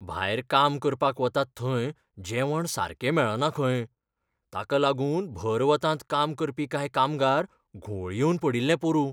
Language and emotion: Goan Konkani, fearful